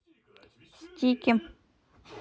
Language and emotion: Russian, neutral